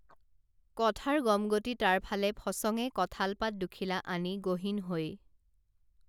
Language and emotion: Assamese, neutral